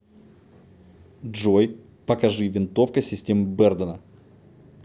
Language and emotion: Russian, neutral